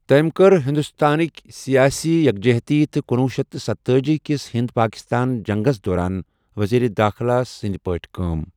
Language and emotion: Kashmiri, neutral